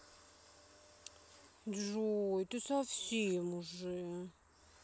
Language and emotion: Russian, sad